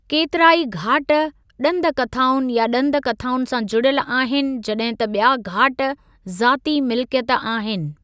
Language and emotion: Sindhi, neutral